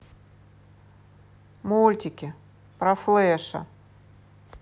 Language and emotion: Russian, neutral